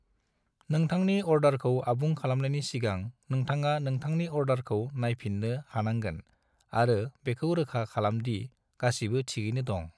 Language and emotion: Bodo, neutral